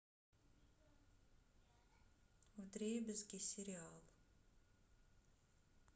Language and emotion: Russian, neutral